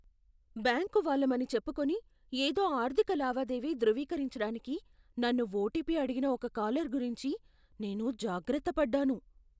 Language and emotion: Telugu, fearful